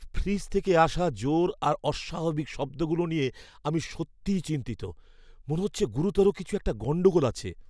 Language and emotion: Bengali, fearful